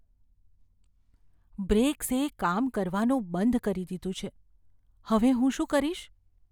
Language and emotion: Gujarati, fearful